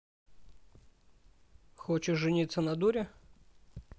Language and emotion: Russian, neutral